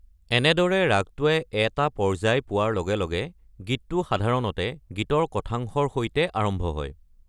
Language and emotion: Assamese, neutral